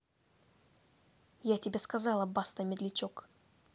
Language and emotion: Russian, angry